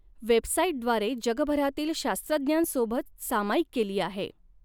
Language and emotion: Marathi, neutral